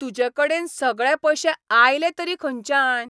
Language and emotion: Goan Konkani, angry